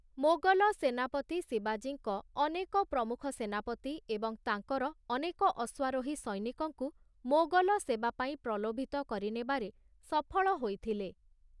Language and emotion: Odia, neutral